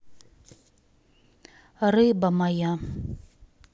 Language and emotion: Russian, neutral